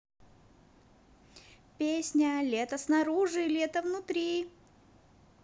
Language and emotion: Russian, positive